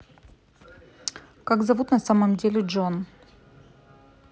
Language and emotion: Russian, neutral